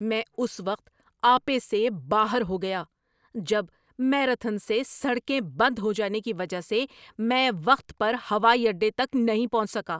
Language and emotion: Urdu, angry